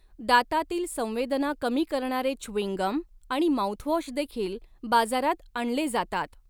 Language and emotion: Marathi, neutral